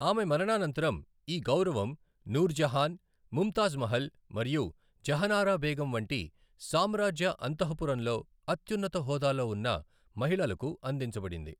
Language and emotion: Telugu, neutral